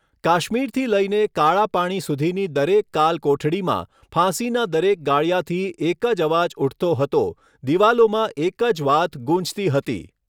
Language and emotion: Gujarati, neutral